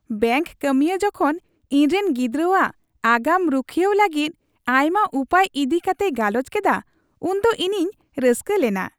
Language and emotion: Santali, happy